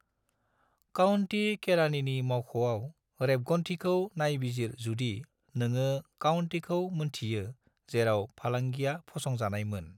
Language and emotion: Bodo, neutral